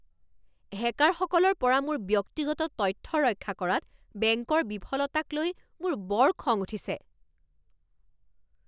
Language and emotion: Assamese, angry